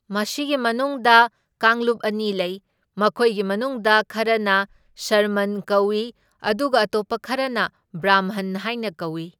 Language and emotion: Manipuri, neutral